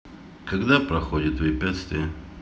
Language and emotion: Russian, neutral